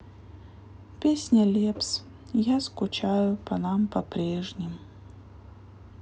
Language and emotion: Russian, sad